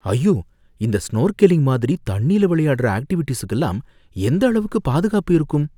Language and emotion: Tamil, fearful